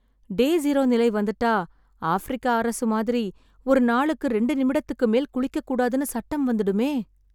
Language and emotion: Tamil, sad